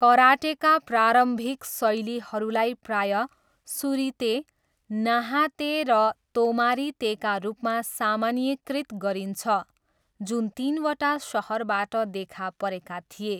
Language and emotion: Nepali, neutral